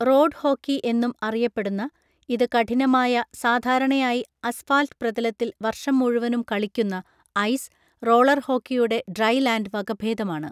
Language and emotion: Malayalam, neutral